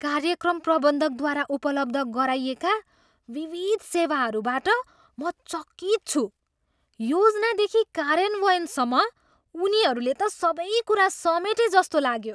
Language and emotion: Nepali, surprised